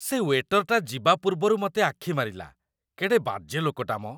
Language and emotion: Odia, disgusted